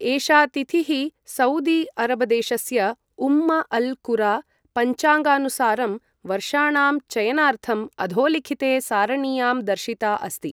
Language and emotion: Sanskrit, neutral